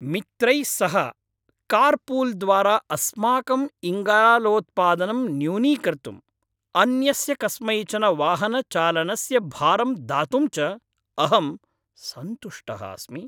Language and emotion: Sanskrit, happy